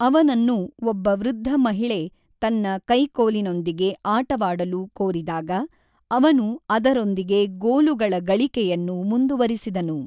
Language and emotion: Kannada, neutral